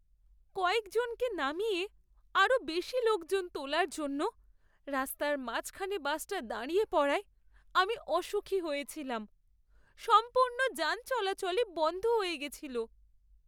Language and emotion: Bengali, sad